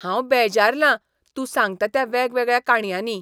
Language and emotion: Goan Konkani, disgusted